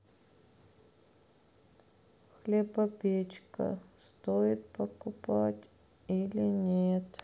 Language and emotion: Russian, sad